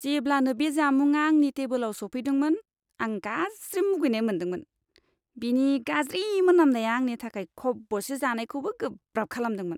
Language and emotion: Bodo, disgusted